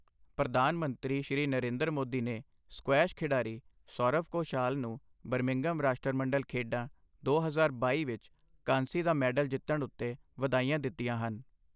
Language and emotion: Punjabi, neutral